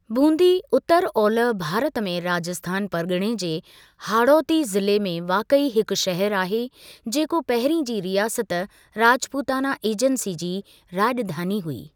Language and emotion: Sindhi, neutral